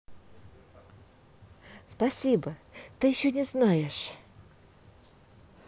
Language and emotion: Russian, positive